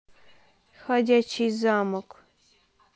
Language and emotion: Russian, neutral